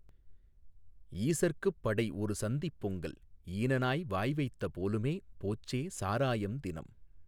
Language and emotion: Tamil, neutral